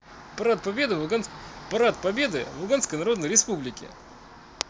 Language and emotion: Russian, positive